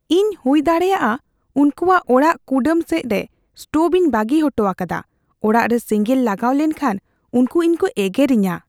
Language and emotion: Santali, fearful